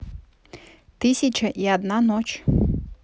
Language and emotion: Russian, neutral